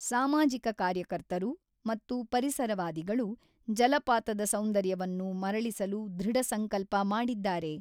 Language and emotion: Kannada, neutral